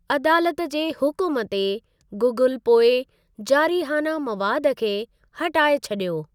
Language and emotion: Sindhi, neutral